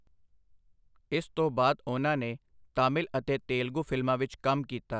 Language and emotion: Punjabi, neutral